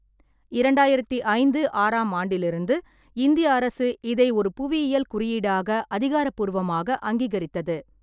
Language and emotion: Tamil, neutral